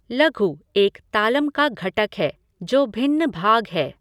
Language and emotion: Hindi, neutral